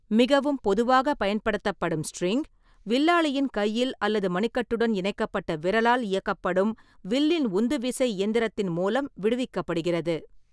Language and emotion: Tamil, neutral